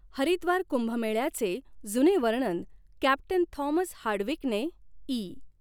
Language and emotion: Marathi, neutral